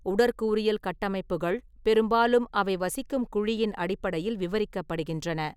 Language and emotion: Tamil, neutral